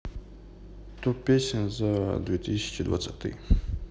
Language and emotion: Russian, neutral